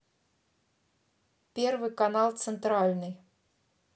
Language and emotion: Russian, neutral